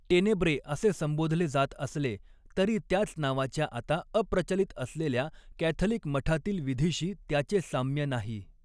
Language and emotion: Marathi, neutral